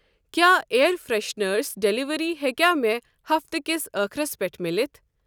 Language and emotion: Kashmiri, neutral